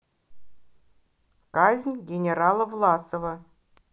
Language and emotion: Russian, neutral